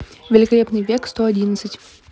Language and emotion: Russian, neutral